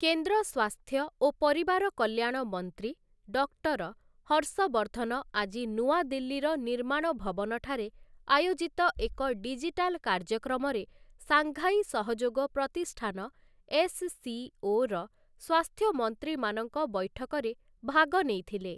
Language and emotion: Odia, neutral